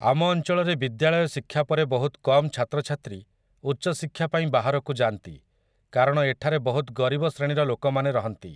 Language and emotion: Odia, neutral